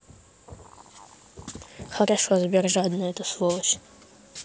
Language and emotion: Russian, neutral